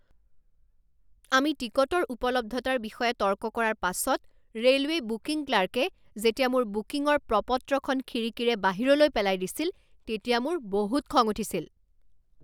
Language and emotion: Assamese, angry